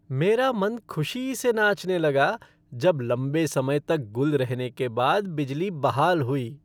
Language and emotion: Hindi, happy